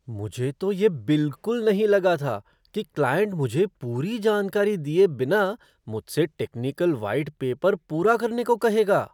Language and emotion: Hindi, surprised